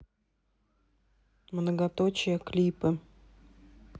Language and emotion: Russian, neutral